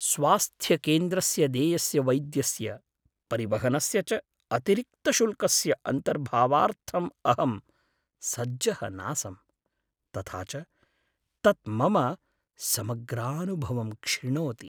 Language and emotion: Sanskrit, sad